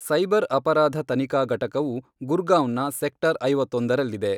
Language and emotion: Kannada, neutral